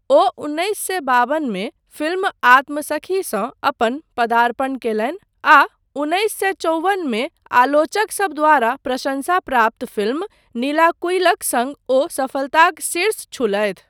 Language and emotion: Maithili, neutral